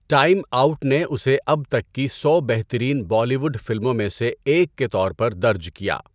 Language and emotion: Urdu, neutral